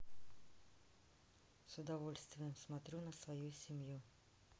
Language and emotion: Russian, neutral